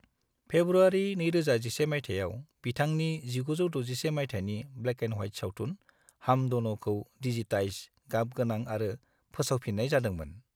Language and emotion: Bodo, neutral